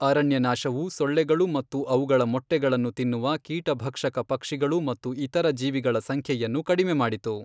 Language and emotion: Kannada, neutral